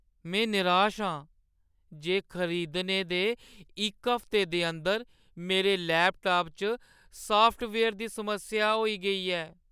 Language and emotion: Dogri, sad